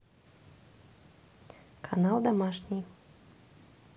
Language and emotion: Russian, neutral